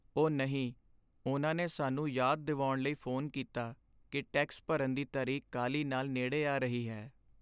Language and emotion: Punjabi, sad